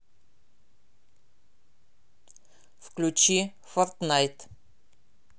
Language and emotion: Russian, neutral